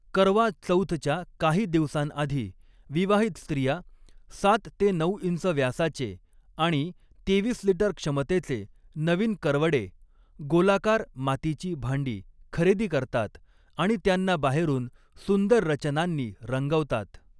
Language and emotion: Marathi, neutral